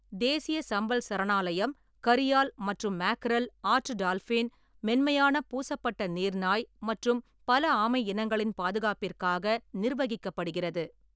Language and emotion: Tamil, neutral